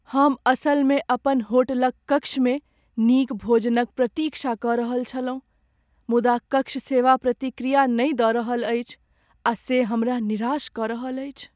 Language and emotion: Maithili, sad